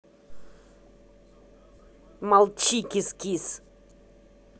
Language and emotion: Russian, angry